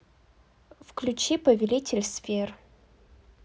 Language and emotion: Russian, neutral